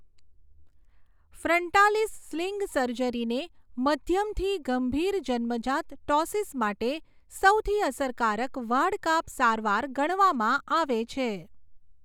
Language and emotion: Gujarati, neutral